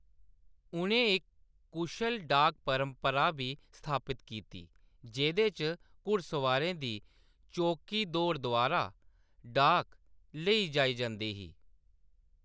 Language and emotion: Dogri, neutral